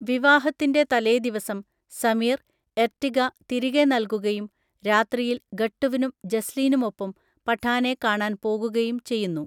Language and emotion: Malayalam, neutral